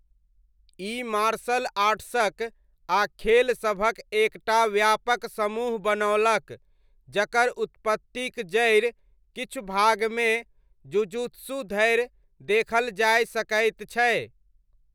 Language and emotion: Maithili, neutral